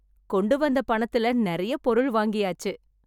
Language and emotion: Tamil, happy